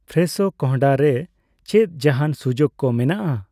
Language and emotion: Santali, neutral